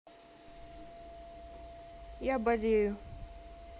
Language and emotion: Russian, sad